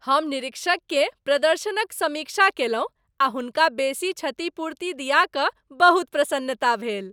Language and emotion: Maithili, happy